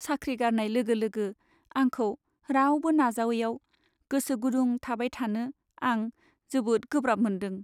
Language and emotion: Bodo, sad